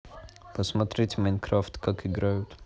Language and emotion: Russian, neutral